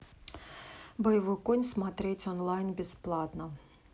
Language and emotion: Russian, neutral